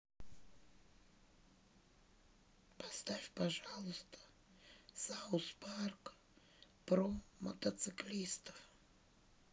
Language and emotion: Russian, sad